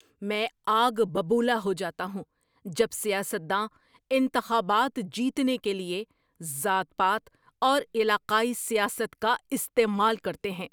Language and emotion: Urdu, angry